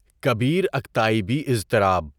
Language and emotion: Urdu, neutral